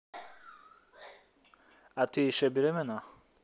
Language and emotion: Russian, neutral